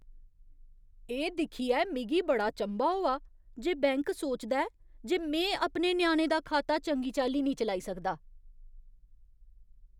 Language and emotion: Dogri, disgusted